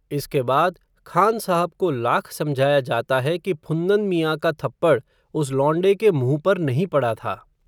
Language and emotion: Hindi, neutral